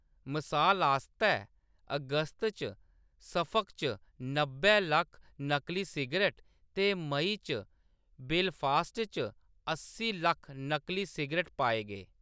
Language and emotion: Dogri, neutral